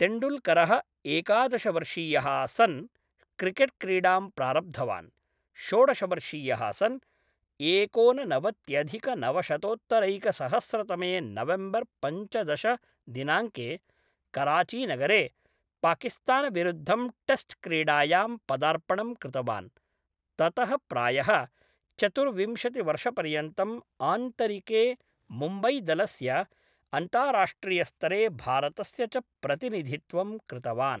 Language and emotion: Sanskrit, neutral